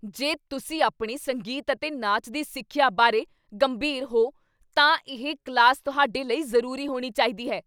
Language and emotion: Punjabi, angry